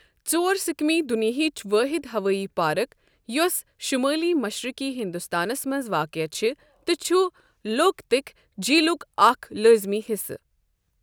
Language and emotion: Kashmiri, neutral